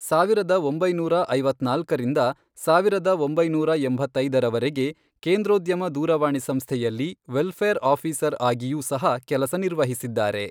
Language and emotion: Kannada, neutral